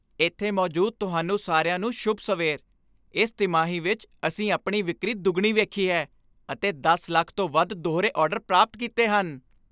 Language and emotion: Punjabi, happy